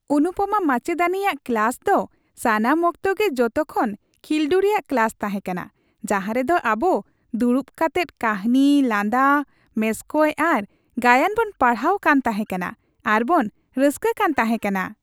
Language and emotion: Santali, happy